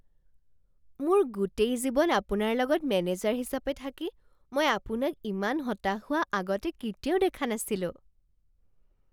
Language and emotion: Assamese, surprised